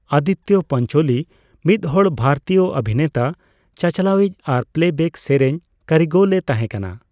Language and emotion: Santali, neutral